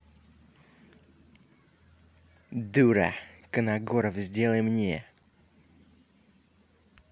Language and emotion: Russian, angry